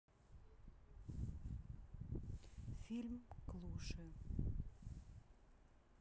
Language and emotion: Russian, neutral